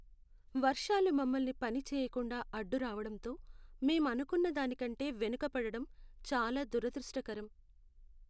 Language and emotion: Telugu, sad